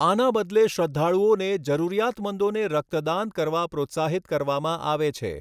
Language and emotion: Gujarati, neutral